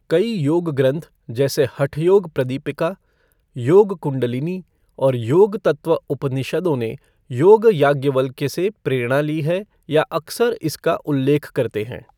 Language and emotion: Hindi, neutral